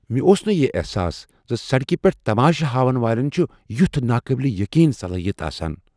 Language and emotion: Kashmiri, surprised